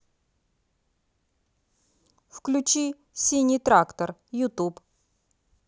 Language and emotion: Russian, neutral